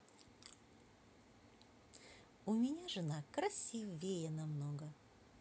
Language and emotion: Russian, positive